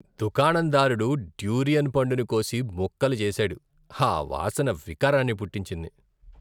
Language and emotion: Telugu, disgusted